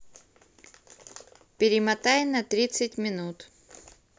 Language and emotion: Russian, neutral